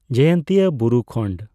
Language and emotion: Santali, neutral